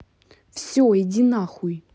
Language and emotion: Russian, angry